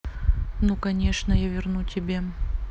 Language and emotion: Russian, neutral